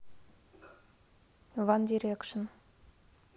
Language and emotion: Russian, neutral